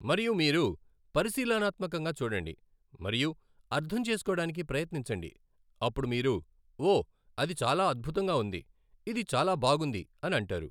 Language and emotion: Telugu, neutral